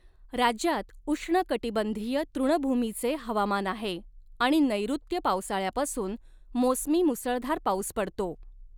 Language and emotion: Marathi, neutral